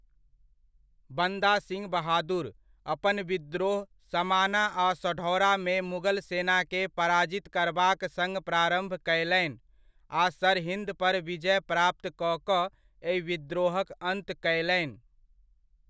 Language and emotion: Maithili, neutral